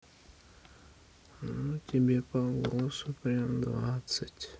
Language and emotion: Russian, sad